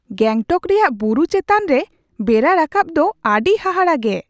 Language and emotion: Santali, surprised